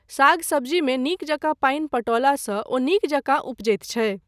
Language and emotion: Maithili, neutral